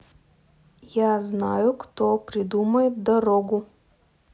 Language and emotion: Russian, neutral